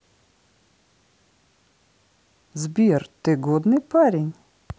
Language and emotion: Russian, positive